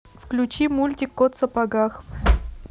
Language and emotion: Russian, neutral